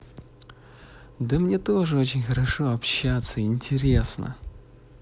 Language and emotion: Russian, positive